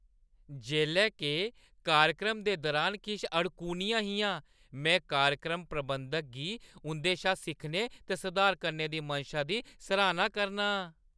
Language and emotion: Dogri, happy